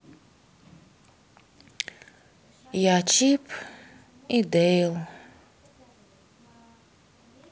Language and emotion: Russian, sad